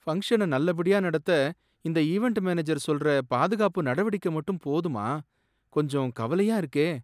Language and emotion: Tamil, sad